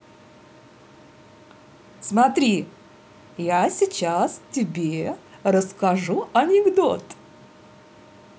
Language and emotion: Russian, positive